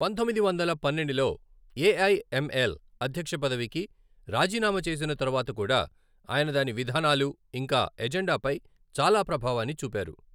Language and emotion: Telugu, neutral